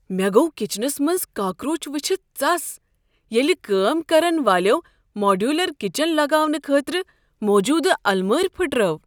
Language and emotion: Kashmiri, surprised